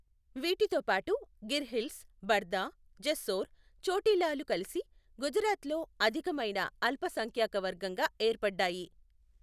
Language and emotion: Telugu, neutral